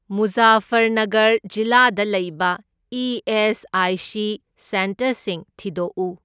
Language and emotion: Manipuri, neutral